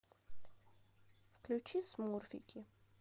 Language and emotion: Russian, neutral